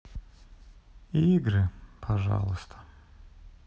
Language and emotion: Russian, sad